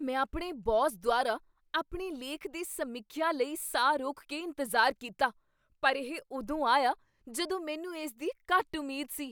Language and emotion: Punjabi, surprised